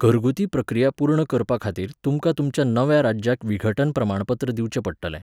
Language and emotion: Goan Konkani, neutral